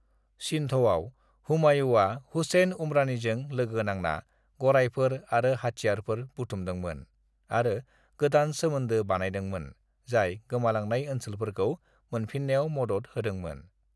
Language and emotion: Bodo, neutral